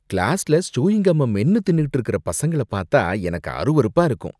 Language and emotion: Tamil, disgusted